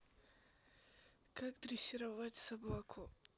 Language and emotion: Russian, neutral